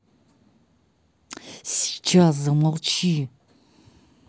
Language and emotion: Russian, angry